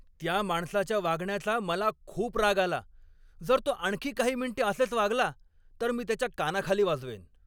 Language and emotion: Marathi, angry